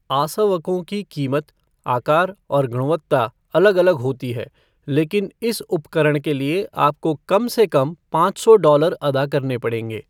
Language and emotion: Hindi, neutral